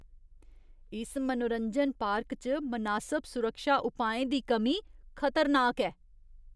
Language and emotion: Dogri, disgusted